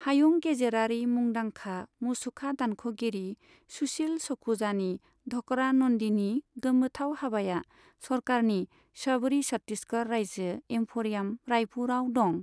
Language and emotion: Bodo, neutral